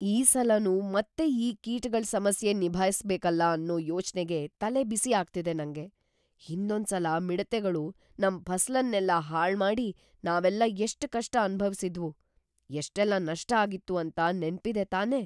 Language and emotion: Kannada, fearful